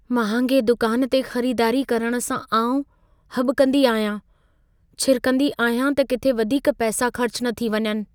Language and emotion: Sindhi, fearful